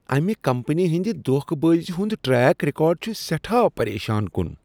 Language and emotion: Kashmiri, disgusted